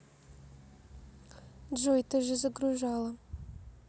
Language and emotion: Russian, neutral